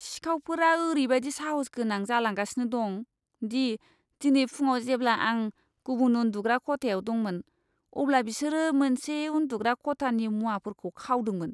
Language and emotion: Bodo, disgusted